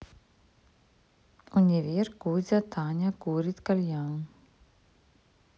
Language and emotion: Russian, neutral